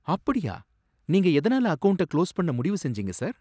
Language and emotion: Tamil, surprised